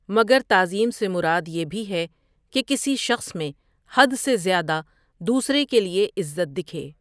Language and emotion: Urdu, neutral